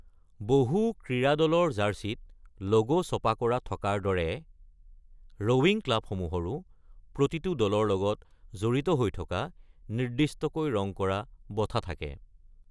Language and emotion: Assamese, neutral